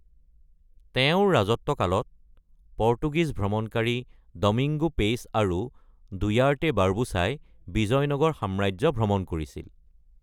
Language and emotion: Assamese, neutral